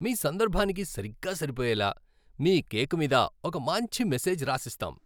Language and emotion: Telugu, happy